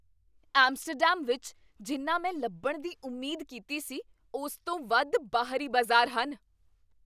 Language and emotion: Punjabi, surprised